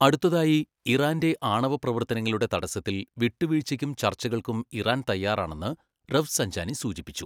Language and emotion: Malayalam, neutral